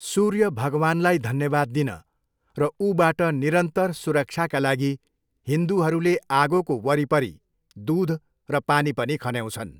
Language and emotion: Nepali, neutral